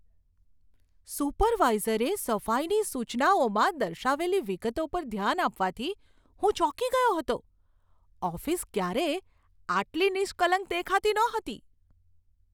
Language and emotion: Gujarati, surprised